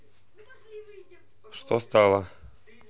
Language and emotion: Russian, neutral